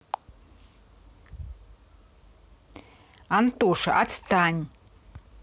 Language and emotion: Russian, angry